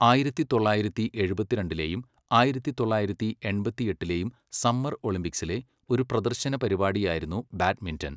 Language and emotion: Malayalam, neutral